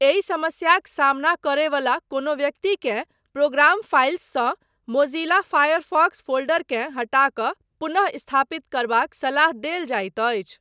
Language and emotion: Maithili, neutral